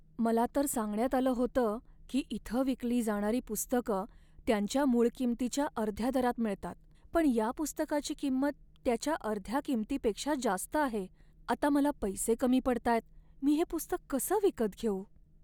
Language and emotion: Marathi, sad